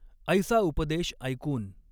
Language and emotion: Marathi, neutral